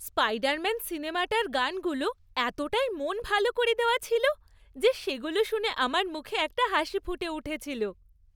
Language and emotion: Bengali, happy